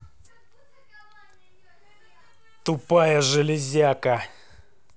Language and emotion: Russian, angry